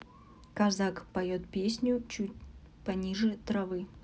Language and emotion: Russian, neutral